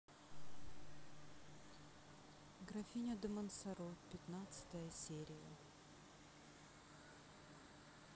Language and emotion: Russian, neutral